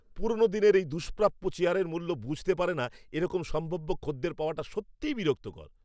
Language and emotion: Bengali, angry